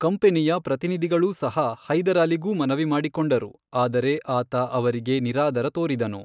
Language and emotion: Kannada, neutral